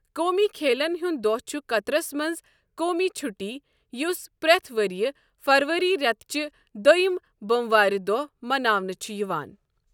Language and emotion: Kashmiri, neutral